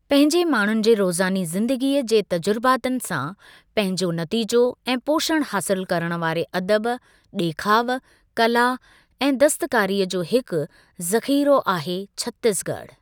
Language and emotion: Sindhi, neutral